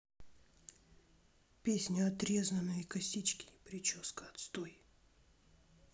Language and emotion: Russian, sad